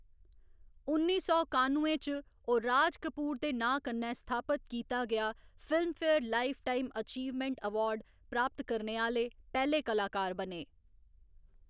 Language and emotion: Dogri, neutral